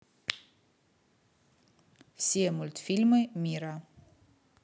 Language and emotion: Russian, neutral